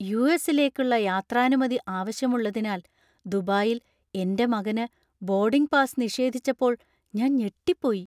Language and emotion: Malayalam, surprised